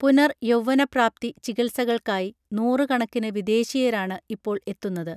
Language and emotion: Malayalam, neutral